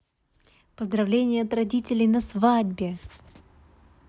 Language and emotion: Russian, positive